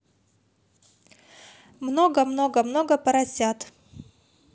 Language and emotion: Russian, neutral